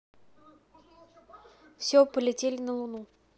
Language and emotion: Russian, neutral